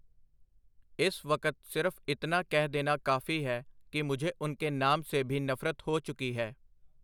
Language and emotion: Punjabi, neutral